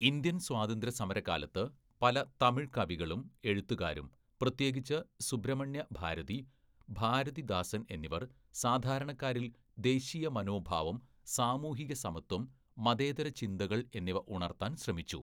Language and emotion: Malayalam, neutral